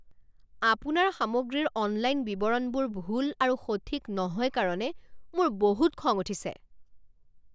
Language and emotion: Assamese, angry